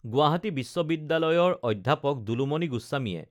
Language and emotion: Assamese, neutral